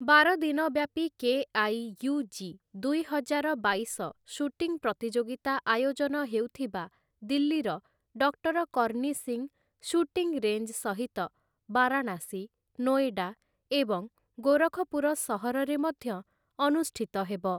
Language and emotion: Odia, neutral